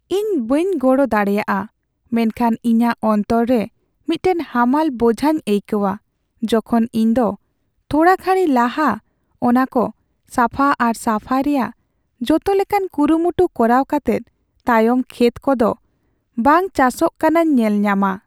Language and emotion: Santali, sad